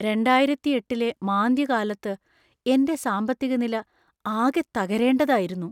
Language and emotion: Malayalam, fearful